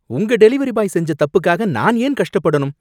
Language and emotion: Tamil, angry